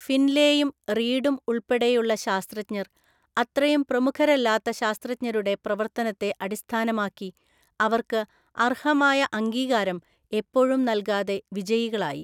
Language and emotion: Malayalam, neutral